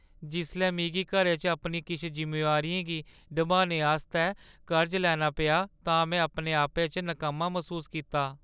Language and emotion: Dogri, sad